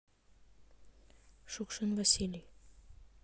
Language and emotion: Russian, neutral